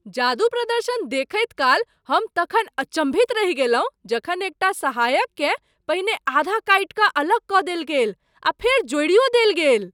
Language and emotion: Maithili, surprised